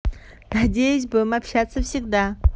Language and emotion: Russian, positive